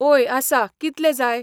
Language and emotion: Goan Konkani, neutral